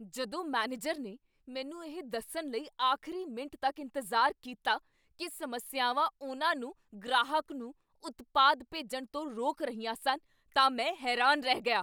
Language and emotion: Punjabi, angry